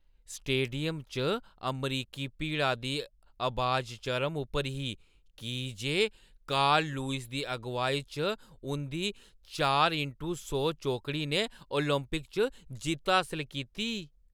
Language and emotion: Dogri, happy